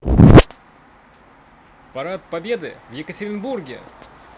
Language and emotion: Russian, positive